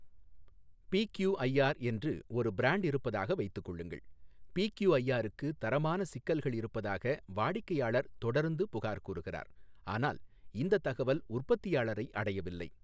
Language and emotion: Tamil, neutral